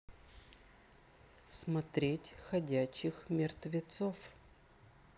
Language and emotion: Russian, neutral